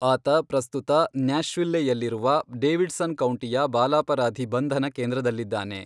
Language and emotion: Kannada, neutral